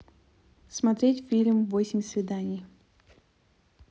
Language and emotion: Russian, neutral